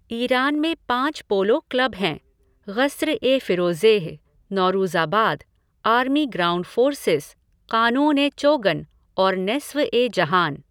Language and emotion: Hindi, neutral